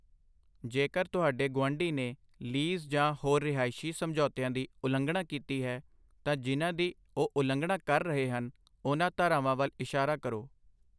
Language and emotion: Punjabi, neutral